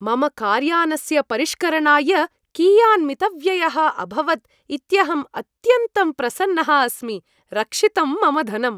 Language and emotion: Sanskrit, happy